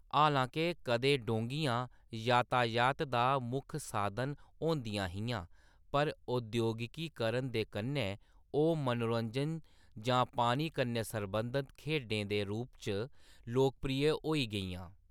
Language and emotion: Dogri, neutral